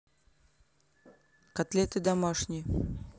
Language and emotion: Russian, neutral